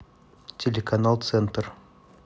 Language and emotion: Russian, neutral